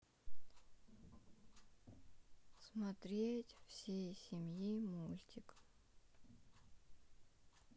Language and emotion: Russian, sad